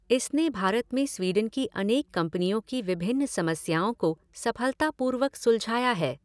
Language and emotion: Hindi, neutral